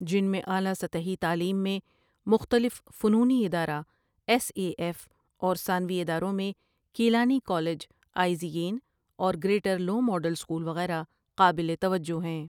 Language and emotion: Urdu, neutral